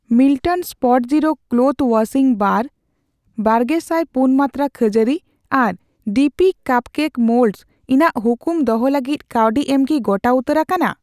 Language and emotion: Santali, neutral